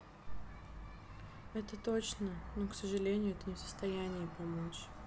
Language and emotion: Russian, sad